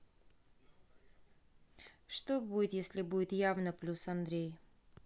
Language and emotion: Russian, neutral